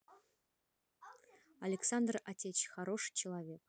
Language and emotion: Russian, neutral